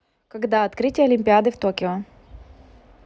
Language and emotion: Russian, neutral